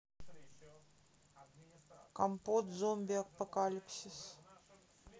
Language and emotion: Russian, neutral